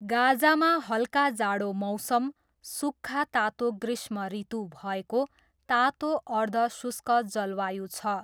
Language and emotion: Nepali, neutral